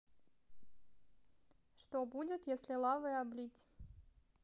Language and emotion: Russian, neutral